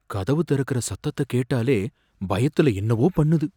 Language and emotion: Tamil, fearful